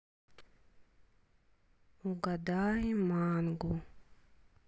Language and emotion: Russian, neutral